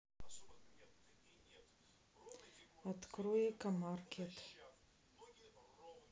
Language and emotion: Russian, neutral